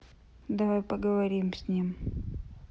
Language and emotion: Russian, neutral